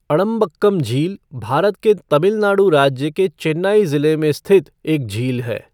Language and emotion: Hindi, neutral